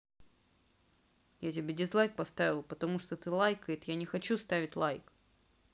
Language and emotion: Russian, angry